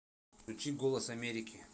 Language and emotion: Russian, neutral